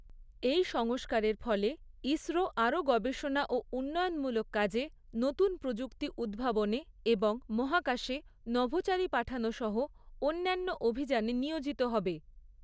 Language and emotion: Bengali, neutral